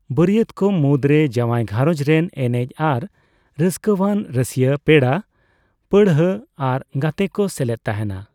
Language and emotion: Santali, neutral